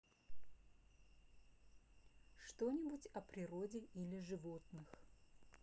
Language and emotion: Russian, neutral